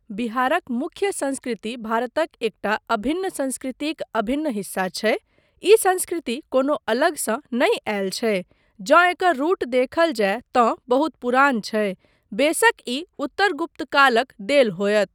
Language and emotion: Maithili, neutral